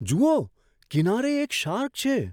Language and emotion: Gujarati, surprised